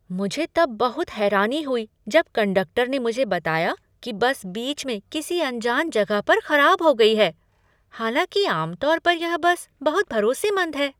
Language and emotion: Hindi, surprised